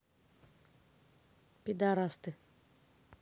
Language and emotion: Russian, neutral